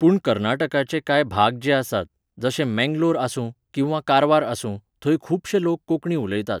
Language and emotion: Goan Konkani, neutral